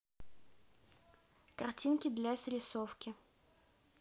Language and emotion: Russian, neutral